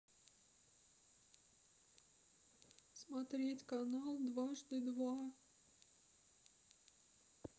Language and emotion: Russian, sad